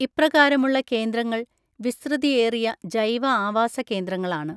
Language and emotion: Malayalam, neutral